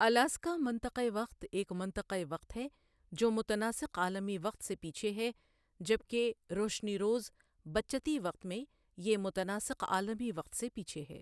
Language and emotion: Urdu, neutral